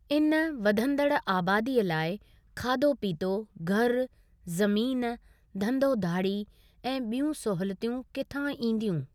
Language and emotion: Sindhi, neutral